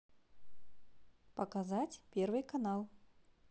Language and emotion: Russian, positive